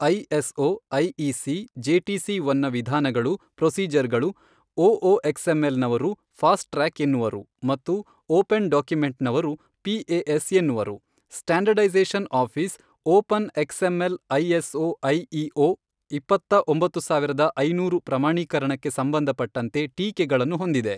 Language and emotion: Kannada, neutral